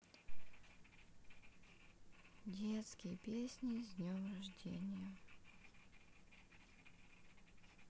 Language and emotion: Russian, sad